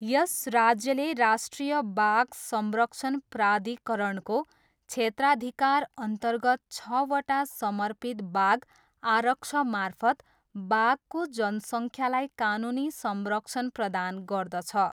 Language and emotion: Nepali, neutral